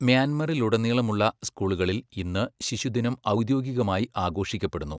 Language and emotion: Malayalam, neutral